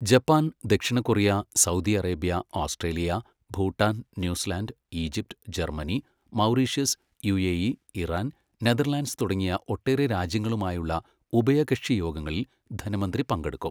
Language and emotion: Malayalam, neutral